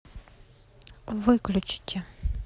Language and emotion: Russian, neutral